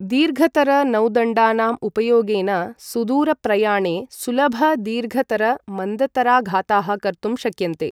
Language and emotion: Sanskrit, neutral